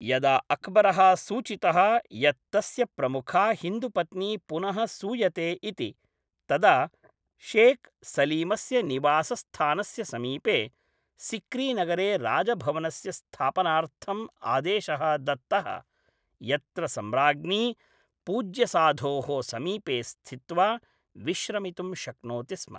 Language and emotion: Sanskrit, neutral